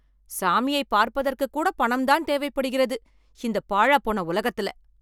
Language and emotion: Tamil, angry